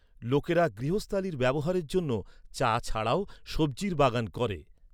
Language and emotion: Bengali, neutral